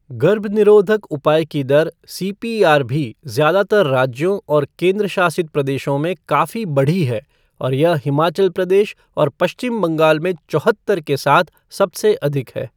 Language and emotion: Hindi, neutral